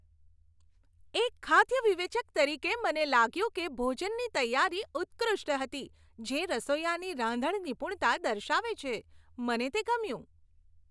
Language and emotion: Gujarati, happy